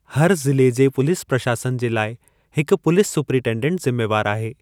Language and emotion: Sindhi, neutral